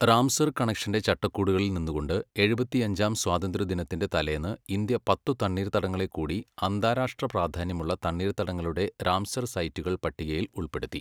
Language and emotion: Malayalam, neutral